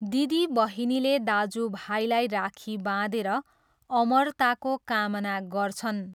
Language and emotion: Nepali, neutral